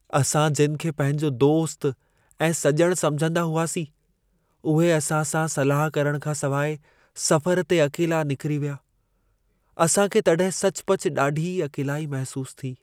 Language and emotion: Sindhi, sad